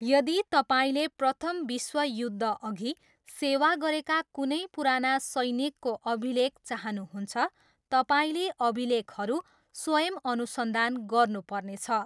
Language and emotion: Nepali, neutral